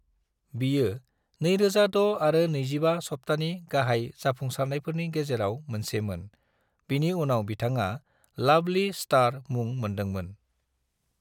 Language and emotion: Bodo, neutral